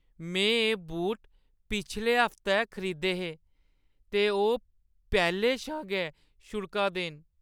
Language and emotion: Dogri, sad